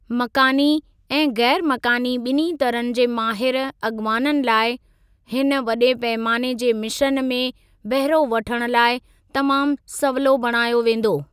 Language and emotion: Sindhi, neutral